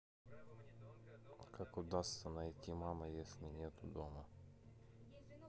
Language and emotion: Russian, neutral